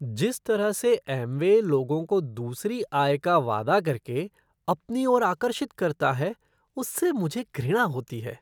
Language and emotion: Hindi, disgusted